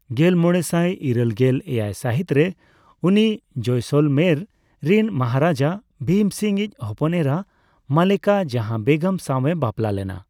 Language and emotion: Santali, neutral